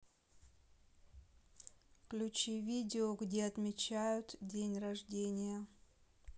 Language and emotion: Russian, neutral